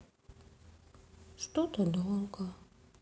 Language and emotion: Russian, sad